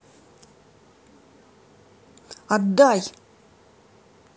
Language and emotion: Russian, angry